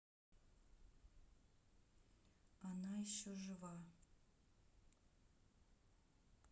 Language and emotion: Russian, neutral